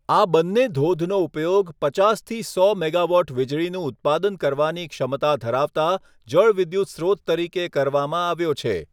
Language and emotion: Gujarati, neutral